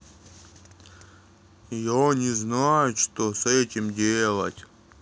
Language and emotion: Russian, neutral